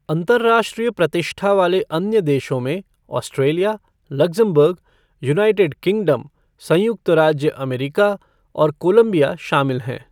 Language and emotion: Hindi, neutral